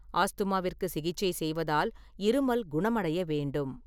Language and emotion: Tamil, neutral